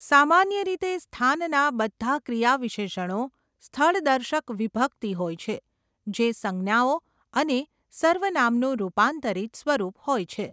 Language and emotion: Gujarati, neutral